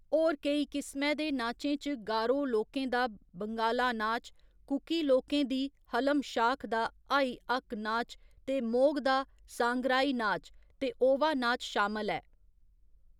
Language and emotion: Dogri, neutral